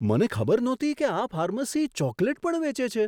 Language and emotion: Gujarati, surprised